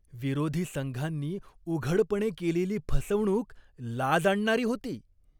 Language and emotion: Marathi, disgusted